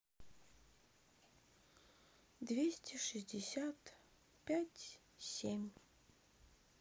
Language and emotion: Russian, sad